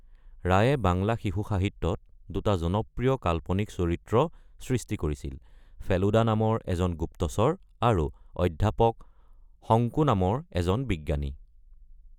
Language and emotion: Assamese, neutral